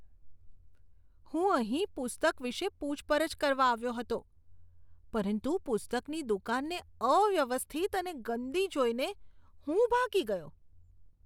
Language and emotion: Gujarati, disgusted